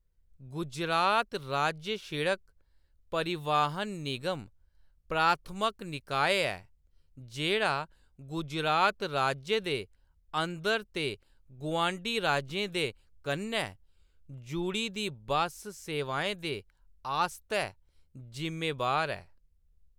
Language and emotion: Dogri, neutral